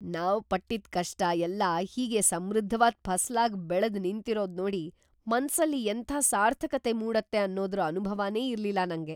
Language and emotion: Kannada, surprised